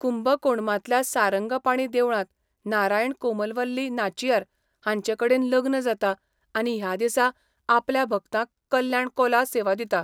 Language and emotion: Goan Konkani, neutral